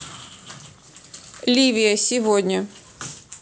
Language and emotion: Russian, neutral